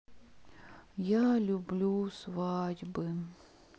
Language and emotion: Russian, sad